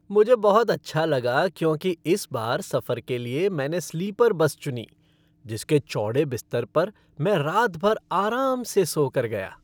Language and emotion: Hindi, happy